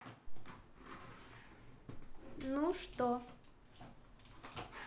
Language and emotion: Russian, neutral